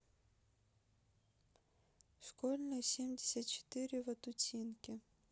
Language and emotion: Russian, neutral